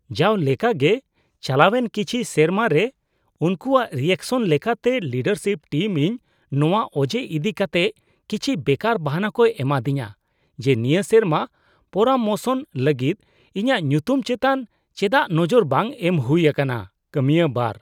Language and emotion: Santali, disgusted